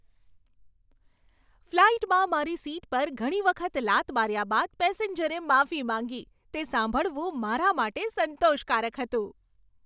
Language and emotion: Gujarati, happy